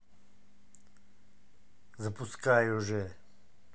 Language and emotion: Russian, angry